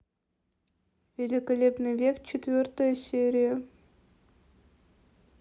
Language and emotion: Russian, neutral